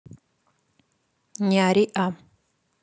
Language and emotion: Russian, neutral